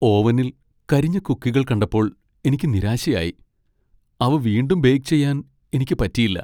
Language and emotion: Malayalam, sad